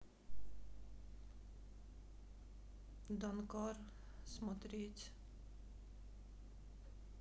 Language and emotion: Russian, sad